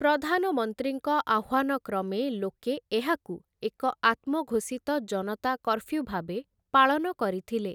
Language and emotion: Odia, neutral